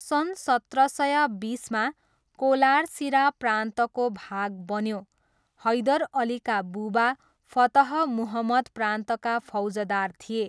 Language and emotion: Nepali, neutral